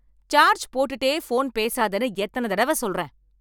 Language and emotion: Tamil, angry